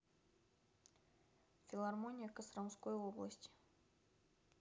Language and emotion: Russian, neutral